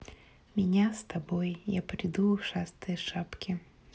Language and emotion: Russian, neutral